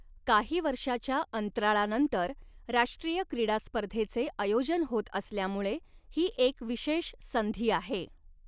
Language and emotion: Marathi, neutral